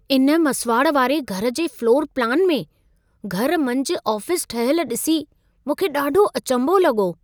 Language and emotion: Sindhi, surprised